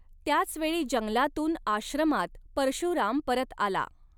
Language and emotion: Marathi, neutral